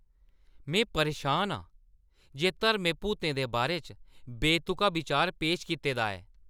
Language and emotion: Dogri, angry